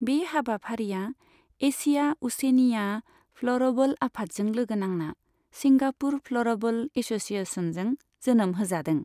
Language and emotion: Bodo, neutral